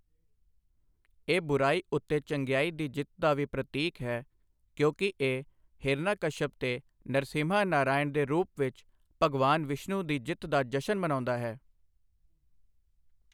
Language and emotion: Punjabi, neutral